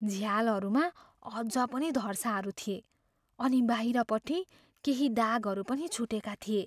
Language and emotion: Nepali, fearful